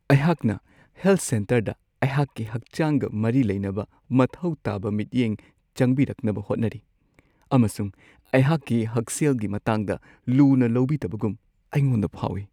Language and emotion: Manipuri, sad